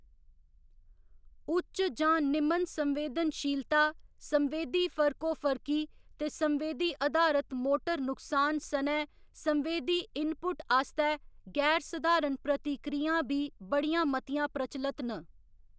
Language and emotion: Dogri, neutral